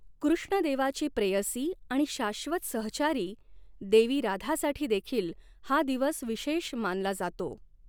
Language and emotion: Marathi, neutral